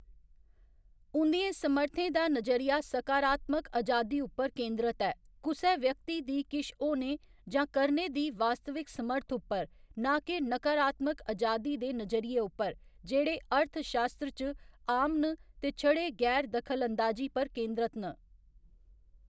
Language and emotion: Dogri, neutral